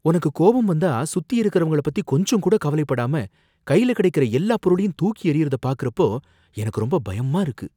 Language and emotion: Tamil, fearful